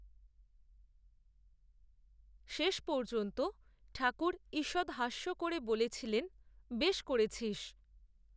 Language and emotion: Bengali, neutral